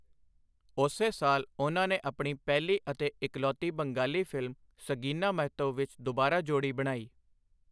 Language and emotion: Punjabi, neutral